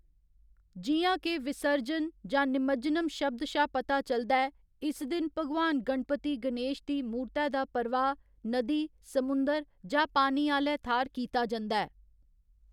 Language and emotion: Dogri, neutral